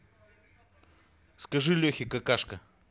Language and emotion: Russian, angry